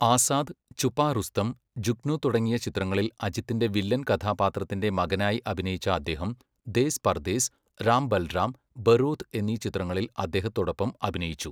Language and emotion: Malayalam, neutral